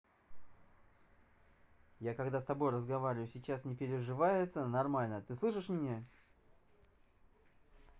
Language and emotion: Russian, angry